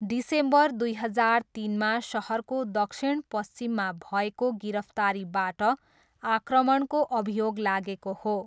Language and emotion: Nepali, neutral